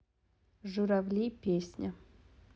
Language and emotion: Russian, neutral